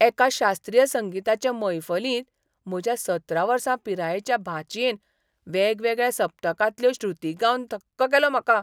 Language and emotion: Goan Konkani, surprised